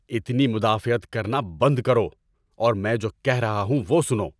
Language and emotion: Urdu, angry